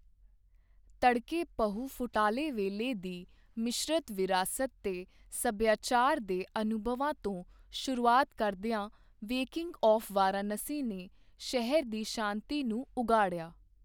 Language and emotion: Punjabi, neutral